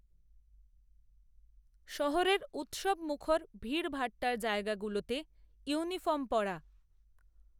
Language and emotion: Bengali, neutral